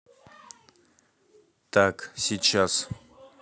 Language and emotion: Russian, neutral